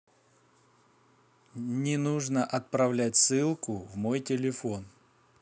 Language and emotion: Russian, neutral